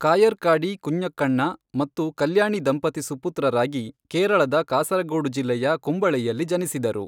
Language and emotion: Kannada, neutral